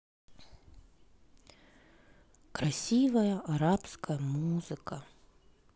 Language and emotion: Russian, sad